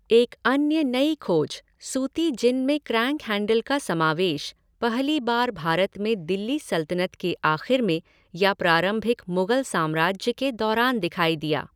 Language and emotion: Hindi, neutral